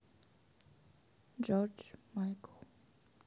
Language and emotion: Russian, sad